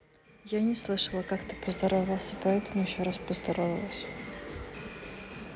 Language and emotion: Russian, neutral